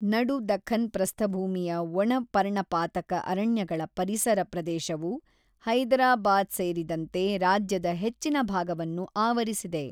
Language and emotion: Kannada, neutral